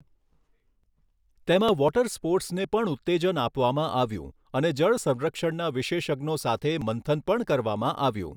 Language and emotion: Gujarati, neutral